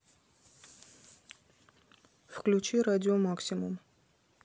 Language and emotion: Russian, neutral